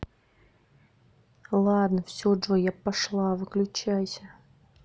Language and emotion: Russian, neutral